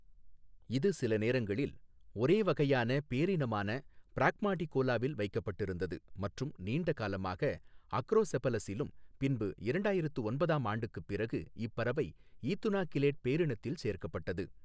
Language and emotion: Tamil, neutral